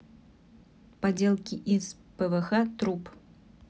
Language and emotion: Russian, neutral